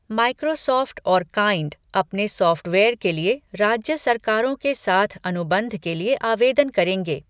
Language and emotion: Hindi, neutral